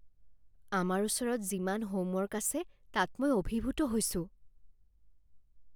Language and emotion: Assamese, fearful